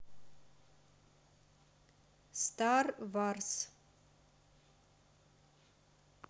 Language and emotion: Russian, neutral